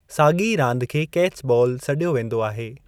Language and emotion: Sindhi, neutral